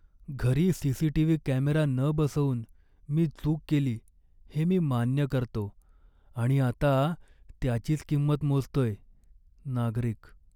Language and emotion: Marathi, sad